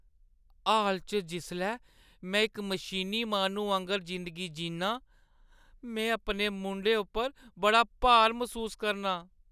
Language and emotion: Dogri, sad